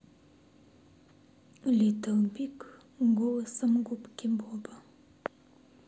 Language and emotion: Russian, neutral